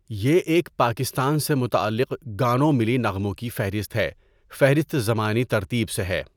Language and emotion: Urdu, neutral